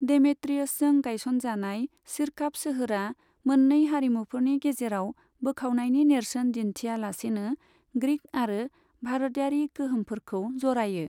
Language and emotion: Bodo, neutral